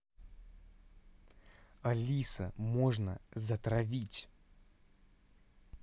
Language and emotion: Russian, angry